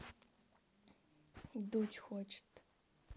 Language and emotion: Russian, neutral